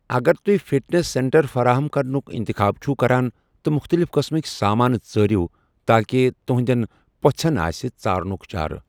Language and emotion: Kashmiri, neutral